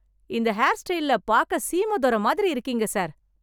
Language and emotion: Tamil, happy